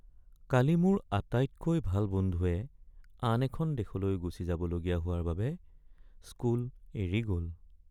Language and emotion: Assamese, sad